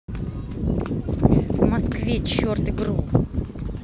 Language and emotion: Russian, angry